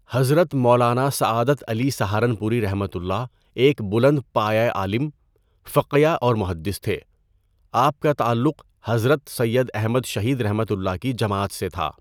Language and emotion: Urdu, neutral